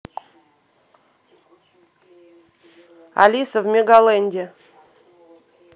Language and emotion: Russian, neutral